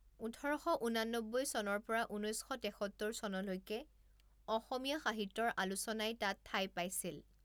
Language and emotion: Assamese, neutral